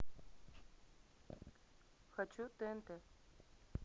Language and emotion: Russian, neutral